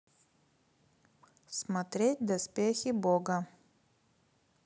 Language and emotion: Russian, neutral